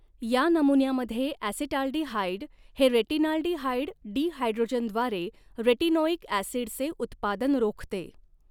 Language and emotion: Marathi, neutral